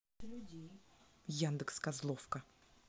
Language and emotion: Russian, angry